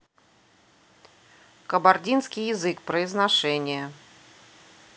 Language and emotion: Russian, neutral